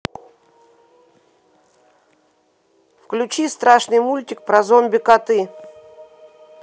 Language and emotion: Russian, neutral